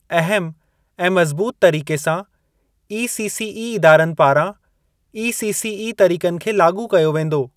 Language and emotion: Sindhi, neutral